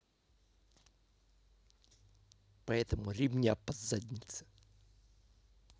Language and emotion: Russian, angry